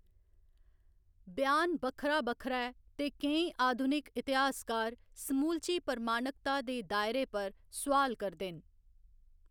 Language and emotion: Dogri, neutral